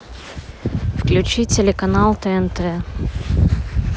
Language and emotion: Russian, neutral